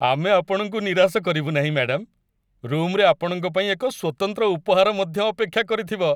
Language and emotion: Odia, happy